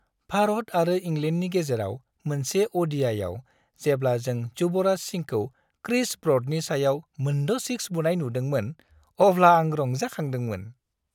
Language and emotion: Bodo, happy